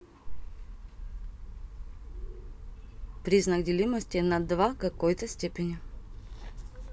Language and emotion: Russian, neutral